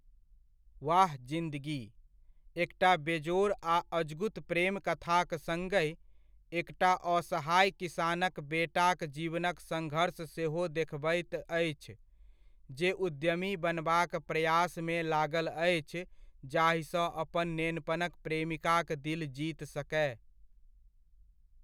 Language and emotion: Maithili, neutral